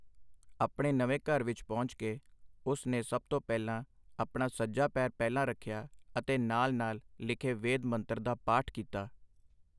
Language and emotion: Punjabi, neutral